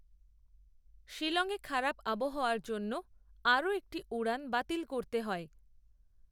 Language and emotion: Bengali, neutral